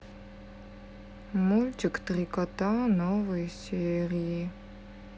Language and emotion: Russian, sad